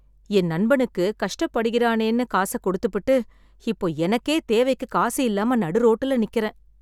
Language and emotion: Tamil, sad